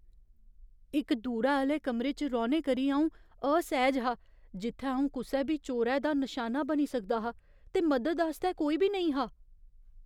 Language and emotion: Dogri, fearful